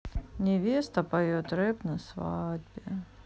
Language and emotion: Russian, sad